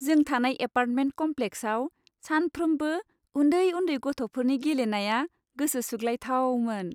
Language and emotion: Bodo, happy